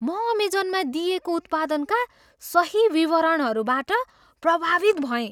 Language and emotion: Nepali, surprised